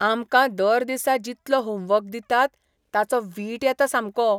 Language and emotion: Goan Konkani, disgusted